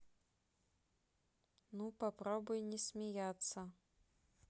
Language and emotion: Russian, neutral